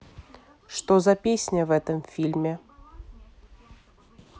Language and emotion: Russian, neutral